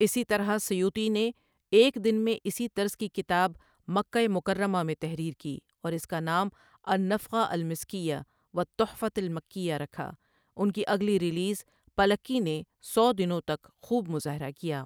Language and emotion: Urdu, neutral